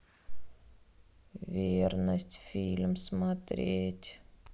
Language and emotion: Russian, sad